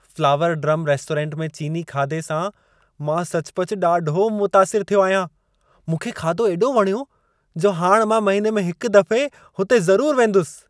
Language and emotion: Sindhi, happy